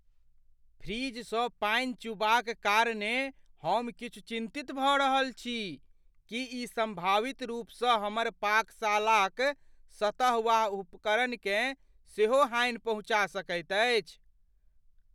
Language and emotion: Maithili, fearful